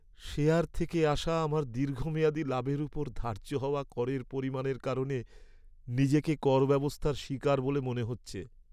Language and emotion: Bengali, sad